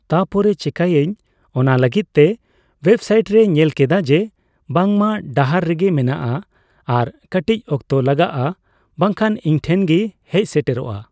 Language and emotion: Santali, neutral